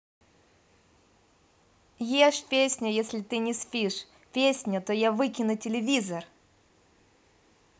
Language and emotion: Russian, positive